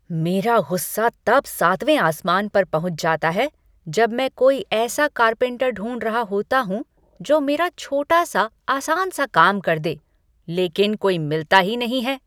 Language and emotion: Hindi, angry